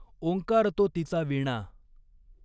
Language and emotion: Marathi, neutral